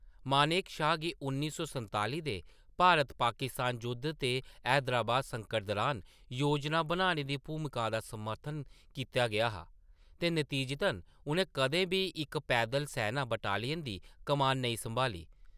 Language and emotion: Dogri, neutral